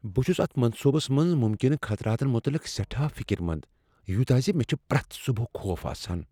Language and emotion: Kashmiri, fearful